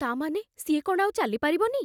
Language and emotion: Odia, fearful